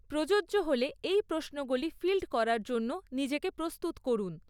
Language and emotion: Bengali, neutral